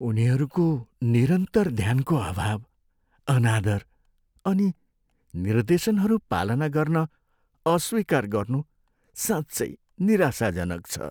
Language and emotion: Nepali, sad